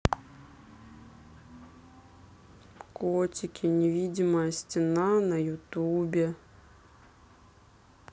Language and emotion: Russian, sad